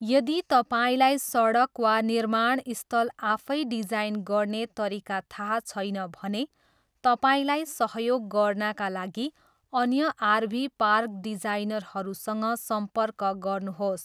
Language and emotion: Nepali, neutral